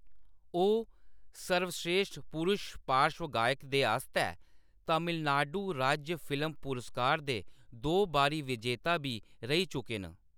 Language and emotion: Dogri, neutral